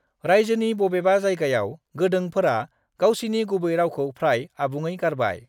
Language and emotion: Bodo, neutral